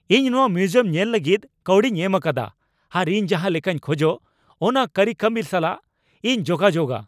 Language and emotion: Santali, angry